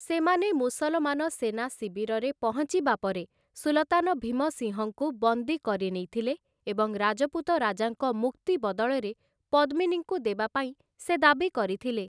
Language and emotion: Odia, neutral